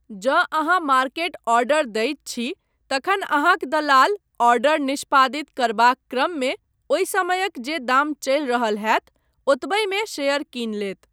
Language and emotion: Maithili, neutral